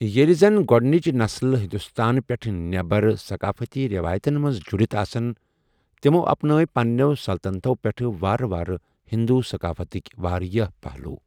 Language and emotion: Kashmiri, neutral